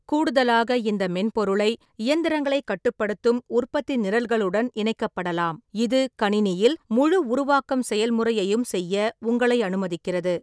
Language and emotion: Tamil, neutral